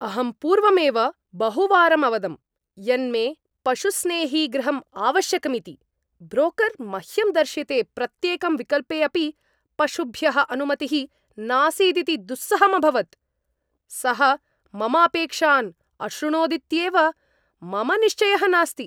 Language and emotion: Sanskrit, angry